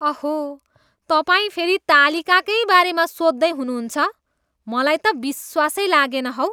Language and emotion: Nepali, disgusted